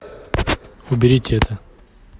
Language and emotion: Russian, neutral